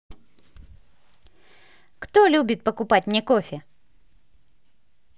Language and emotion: Russian, positive